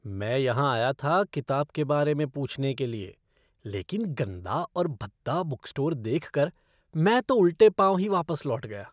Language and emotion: Hindi, disgusted